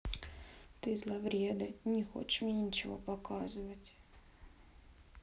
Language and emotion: Russian, sad